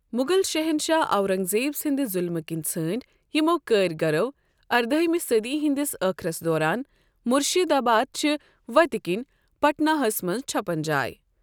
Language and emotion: Kashmiri, neutral